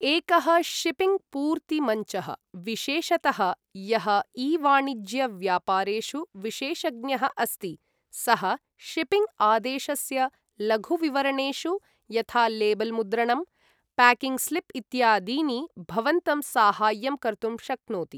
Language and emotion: Sanskrit, neutral